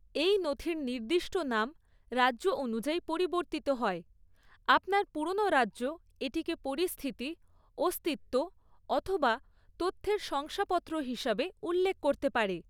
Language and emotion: Bengali, neutral